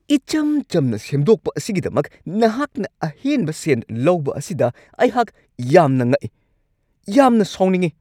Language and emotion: Manipuri, angry